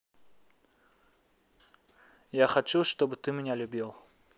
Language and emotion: Russian, neutral